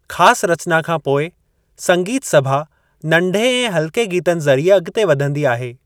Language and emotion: Sindhi, neutral